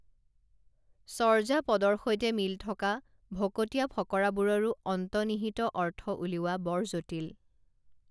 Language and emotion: Assamese, neutral